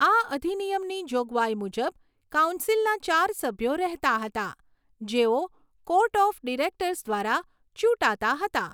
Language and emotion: Gujarati, neutral